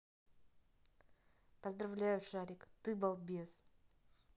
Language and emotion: Russian, neutral